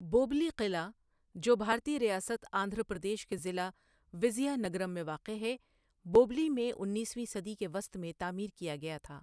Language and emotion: Urdu, neutral